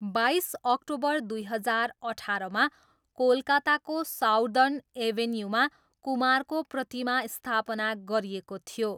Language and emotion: Nepali, neutral